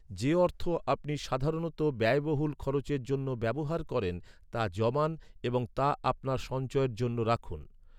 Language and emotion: Bengali, neutral